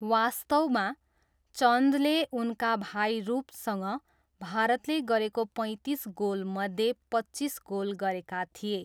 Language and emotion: Nepali, neutral